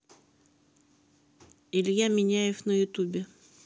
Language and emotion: Russian, neutral